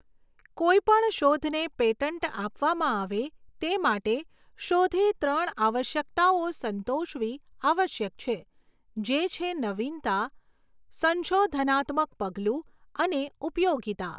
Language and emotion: Gujarati, neutral